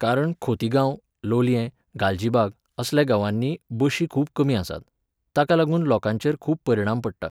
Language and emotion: Goan Konkani, neutral